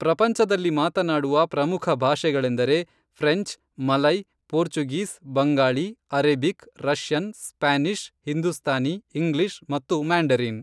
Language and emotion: Kannada, neutral